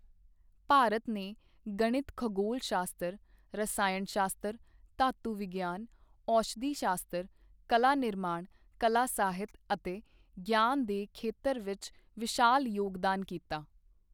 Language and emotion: Punjabi, neutral